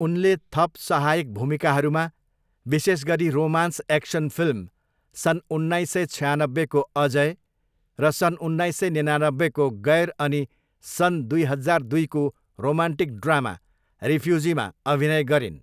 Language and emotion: Nepali, neutral